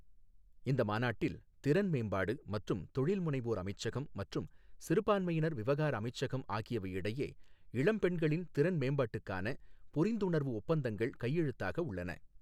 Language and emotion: Tamil, neutral